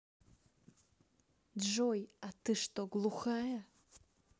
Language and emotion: Russian, neutral